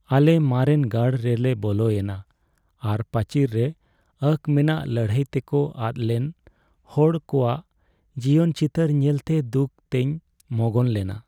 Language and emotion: Santali, sad